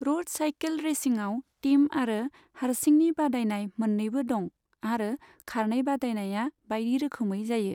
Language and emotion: Bodo, neutral